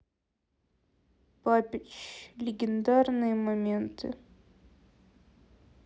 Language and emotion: Russian, sad